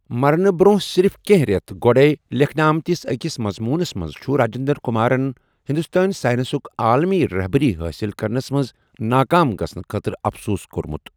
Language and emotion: Kashmiri, neutral